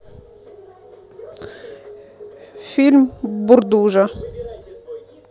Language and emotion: Russian, neutral